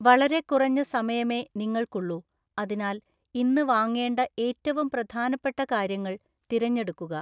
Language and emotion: Malayalam, neutral